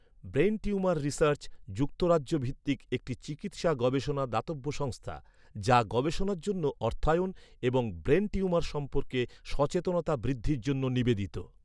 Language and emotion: Bengali, neutral